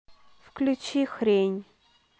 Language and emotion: Russian, neutral